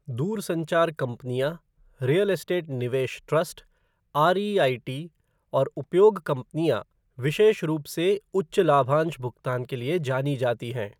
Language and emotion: Hindi, neutral